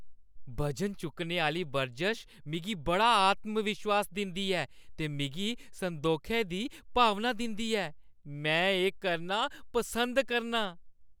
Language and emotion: Dogri, happy